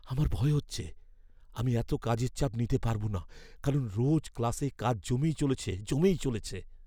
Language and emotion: Bengali, fearful